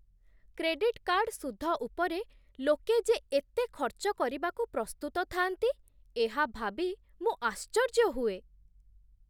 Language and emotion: Odia, surprised